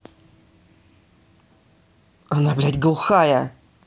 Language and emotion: Russian, angry